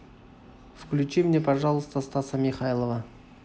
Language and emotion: Russian, neutral